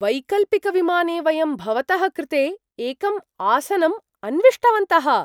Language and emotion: Sanskrit, surprised